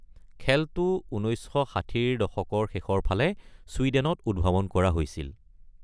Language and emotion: Assamese, neutral